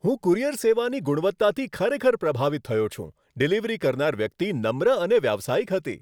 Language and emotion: Gujarati, happy